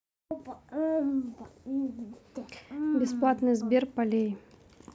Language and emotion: Russian, neutral